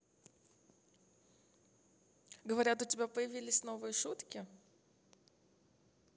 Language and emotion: Russian, positive